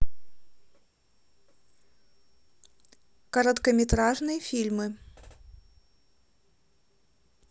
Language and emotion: Russian, neutral